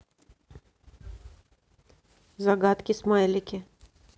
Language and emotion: Russian, neutral